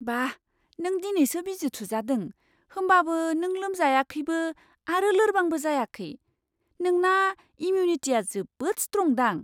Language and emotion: Bodo, surprised